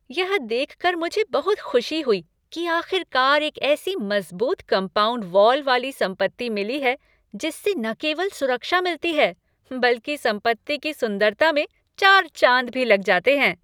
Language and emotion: Hindi, happy